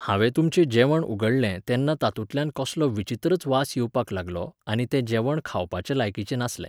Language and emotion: Goan Konkani, neutral